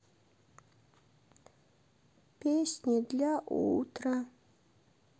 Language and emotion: Russian, sad